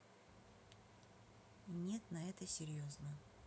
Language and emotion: Russian, neutral